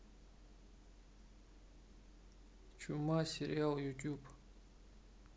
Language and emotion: Russian, neutral